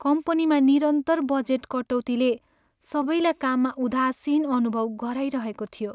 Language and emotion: Nepali, sad